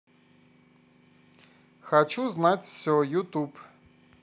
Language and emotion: Russian, positive